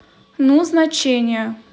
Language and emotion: Russian, neutral